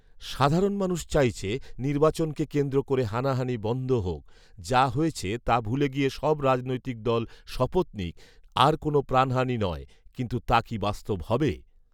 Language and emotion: Bengali, neutral